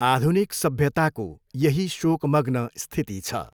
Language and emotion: Nepali, neutral